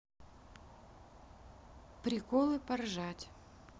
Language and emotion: Russian, neutral